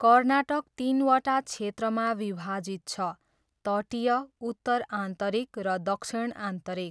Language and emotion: Nepali, neutral